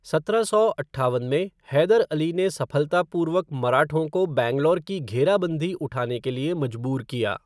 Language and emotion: Hindi, neutral